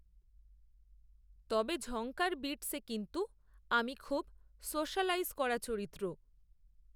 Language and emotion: Bengali, neutral